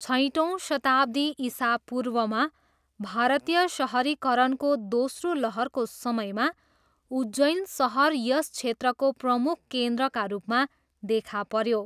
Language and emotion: Nepali, neutral